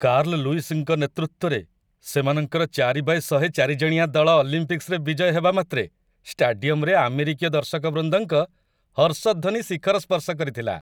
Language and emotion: Odia, happy